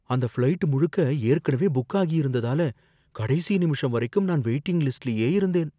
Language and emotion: Tamil, fearful